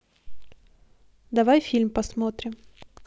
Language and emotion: Russian, neutral